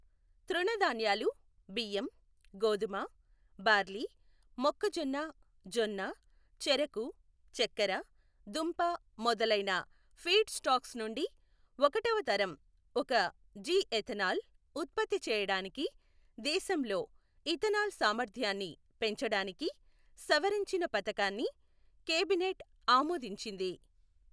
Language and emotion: Telugu, neutral